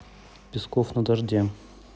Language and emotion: Russian, neutral